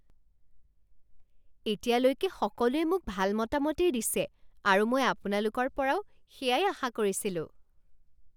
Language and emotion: Assamese, surprised